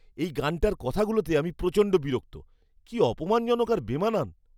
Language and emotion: Bengali, disgusted